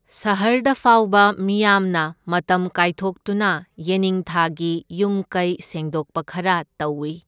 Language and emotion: Manipuri, neutral